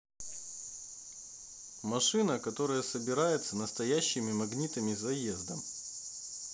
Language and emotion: Russian, neutral